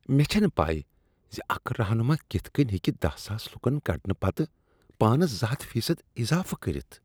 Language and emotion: Kashmiri, disgusted